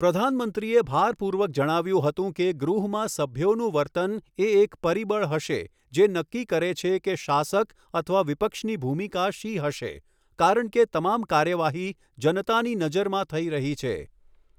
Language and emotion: Gujarati, neutral